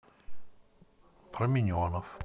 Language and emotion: Russian, neutral